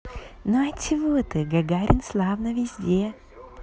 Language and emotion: Russian, positive